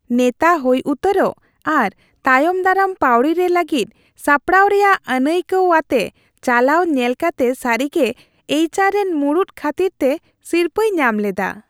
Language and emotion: Santali, happy